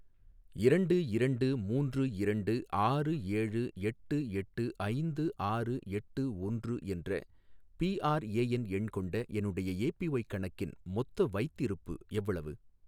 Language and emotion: Tamil, neutral